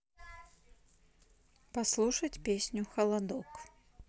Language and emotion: Russian, neutral